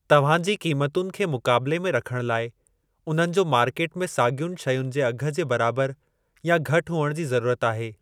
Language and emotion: Sindhi, neutral